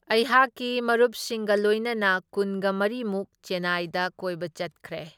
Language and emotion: Manipuri, neutral